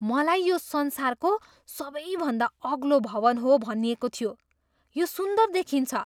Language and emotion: Nepali, surprised